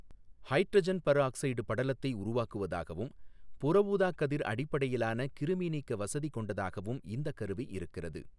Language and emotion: Tamil, neutral